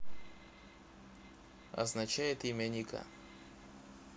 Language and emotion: Russian, neutral